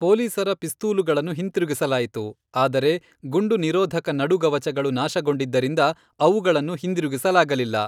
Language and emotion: Kannada, neutral